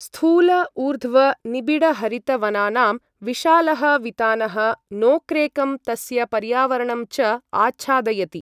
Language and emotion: Sanskrit, neutral